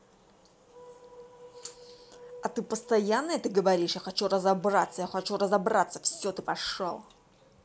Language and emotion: Russian, angry